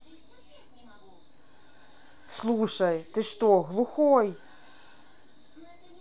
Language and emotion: Russian, angry